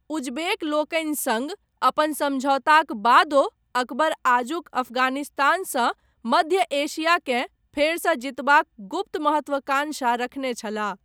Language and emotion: Maithili, neutral